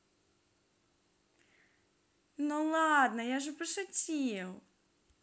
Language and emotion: Russian, positive